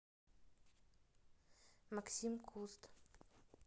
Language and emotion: Russian, neutral